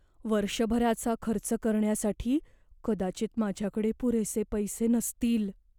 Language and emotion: Marathi, fearful